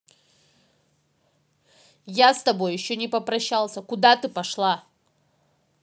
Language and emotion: Russian, angry